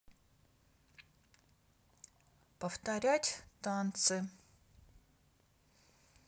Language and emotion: Russian, neutral